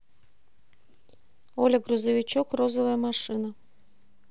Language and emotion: Russian, neutral